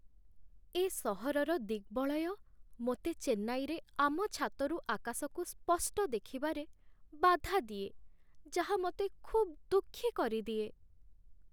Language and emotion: Odia, sad